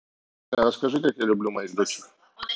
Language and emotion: Russian, neutral